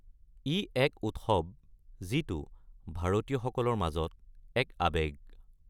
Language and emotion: Assamese, neutral